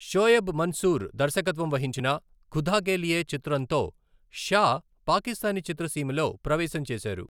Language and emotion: Telugu, neutral